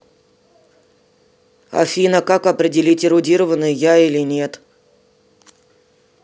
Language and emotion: Russian, neutral